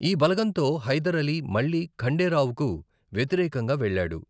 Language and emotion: Telugu, neutral